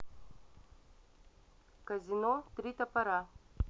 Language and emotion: Russian, neutral